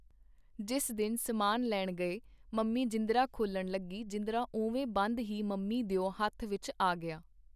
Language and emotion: Punjabi, neutral